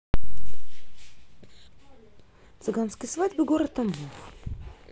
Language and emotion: Russian, neutral